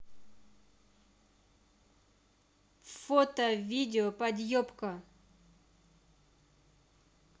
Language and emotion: Russian, angry